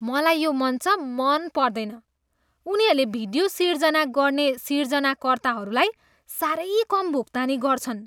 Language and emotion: Nepali, disgusted